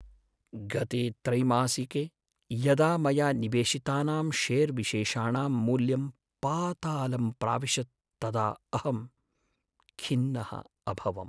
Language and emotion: Sanskrit, sad